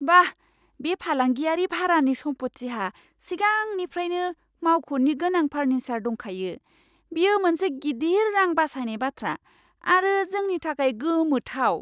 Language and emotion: Bodo, surprised